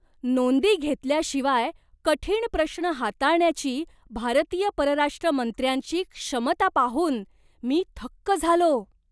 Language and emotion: Marathi, surprised